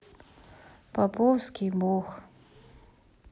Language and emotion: Russian, sad